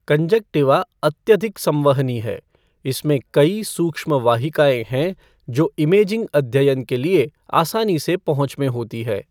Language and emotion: Hindi, neutral